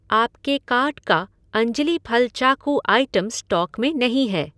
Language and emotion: Hindi, neutral